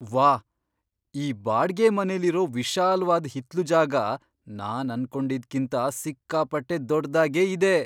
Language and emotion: Kannada, surprised